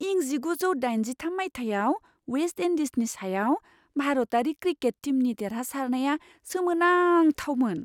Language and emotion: Bodo, surprised